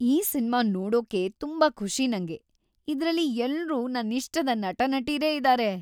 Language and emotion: Kannada, happy